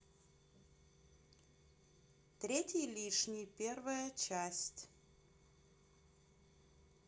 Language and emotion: Russian, neutral